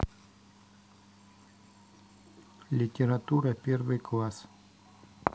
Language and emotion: Russian, neutral